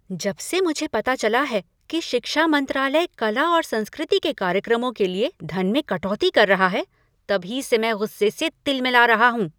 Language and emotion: Hindi, angry